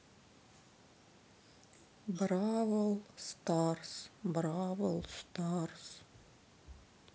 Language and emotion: Russian, sad